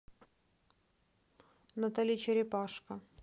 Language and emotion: Russian, neutral